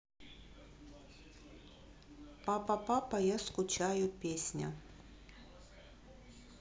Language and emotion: Russian, neutral